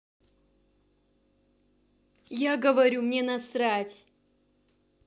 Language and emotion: Russian, angry